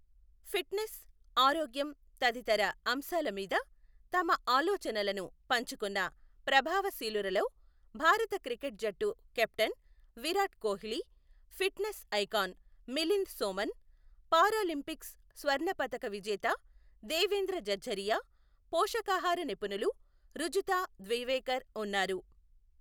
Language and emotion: Telugu, neutral